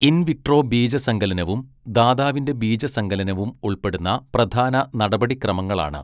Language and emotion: Malayalam, neutral